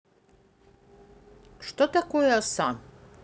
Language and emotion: Russian, neutral